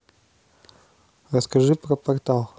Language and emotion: Russian, neutral